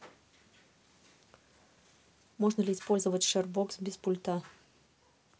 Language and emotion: Russian, neutral